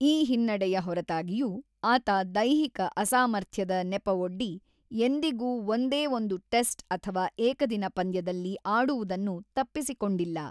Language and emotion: Kannada, neutral